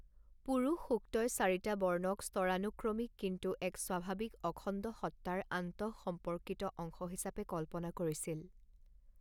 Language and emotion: Assamese, neutral